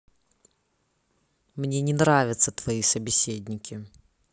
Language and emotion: Russian, angry